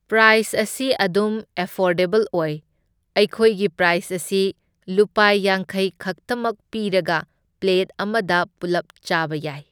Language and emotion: Manipuri, neutral